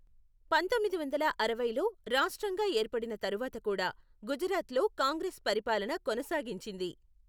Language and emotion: Telugu, neutral